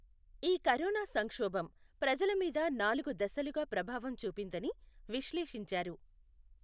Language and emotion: Telugu, neutral